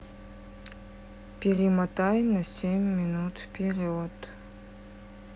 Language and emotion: Russian, sad